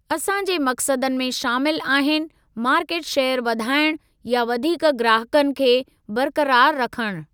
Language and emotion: Sindhi, neutral